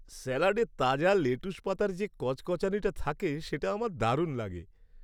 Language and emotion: Bengali, happy